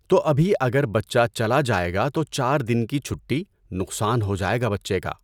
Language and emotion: Urdu, neutral